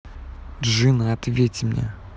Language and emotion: Russian, angry